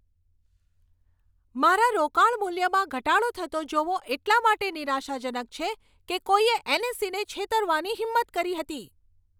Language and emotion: Gujarati, angry